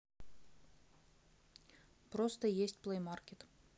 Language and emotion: Russian, neutral